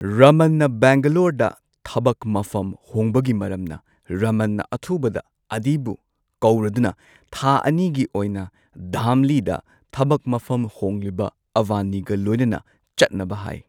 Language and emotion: Manipuri, neutral